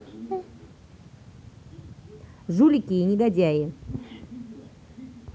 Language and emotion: Russian, angry